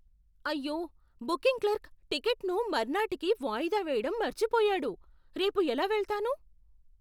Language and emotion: Telugu, surprised